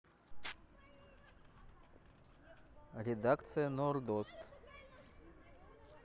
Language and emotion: Russian, neutral